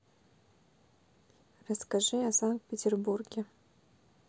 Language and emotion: Russian, neutral